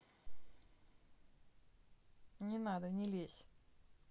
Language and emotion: Russian, neutral